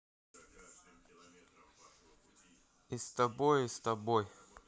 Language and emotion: Russian, neutral